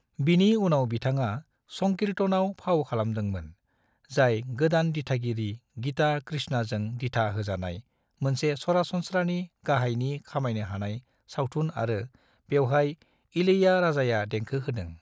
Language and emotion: Bodo, neutral